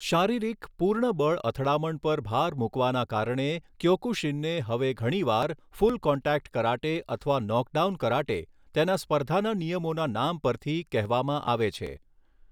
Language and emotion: Gujarati, neutral